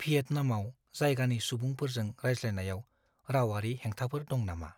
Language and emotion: Bodo, fearful